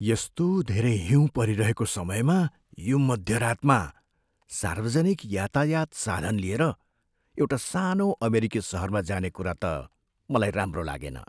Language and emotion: Nepali, fearful